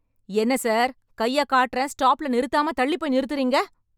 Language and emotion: Tamil, angry